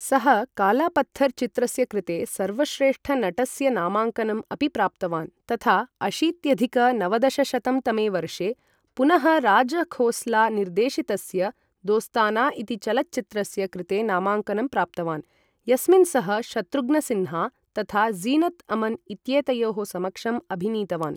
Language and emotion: Sanskrit, neutral